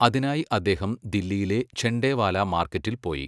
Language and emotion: Malayalam, neutral